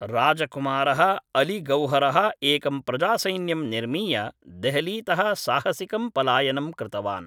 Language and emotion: Sanskrit, neutral